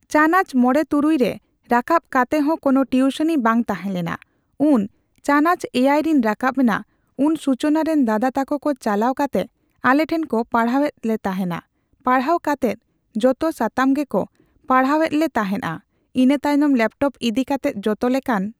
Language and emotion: Santali, neutral